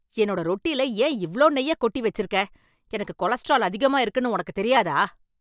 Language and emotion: Tamil, angry